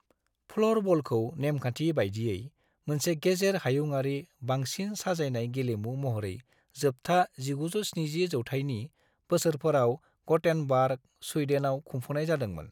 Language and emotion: Bodo, neutral